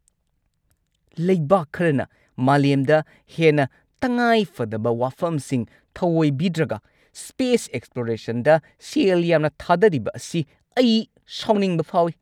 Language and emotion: Manipuri, angry